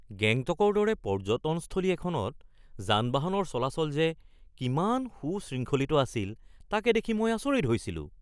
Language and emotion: Assamese, surprised